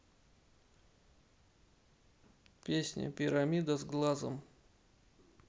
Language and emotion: Russian, neutral